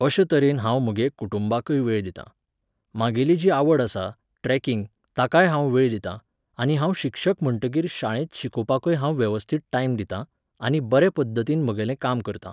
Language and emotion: Goan Konkani, neutral